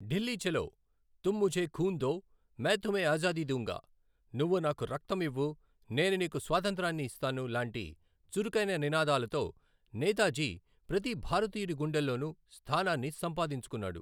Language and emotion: Telugu, neutral